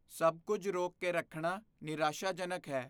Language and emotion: Punjabi, fearful